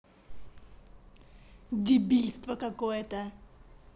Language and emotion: Russian, angry